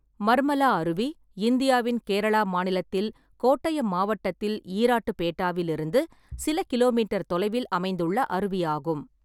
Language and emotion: Tamil, neutral